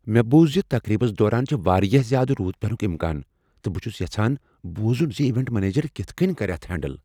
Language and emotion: Kashmiri, fearful